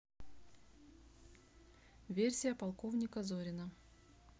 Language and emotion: Russian, neutral